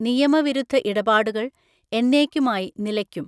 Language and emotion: Malayalam, neutral